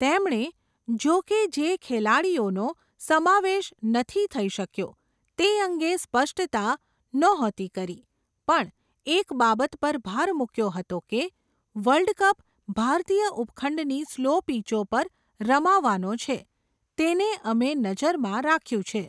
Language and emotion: Gujarati, neutral